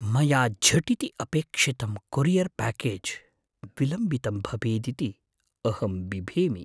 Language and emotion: Sanskrit, fearful